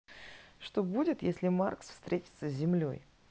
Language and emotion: Russian, neutral